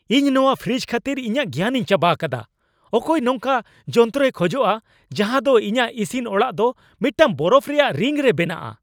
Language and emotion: Santali, angry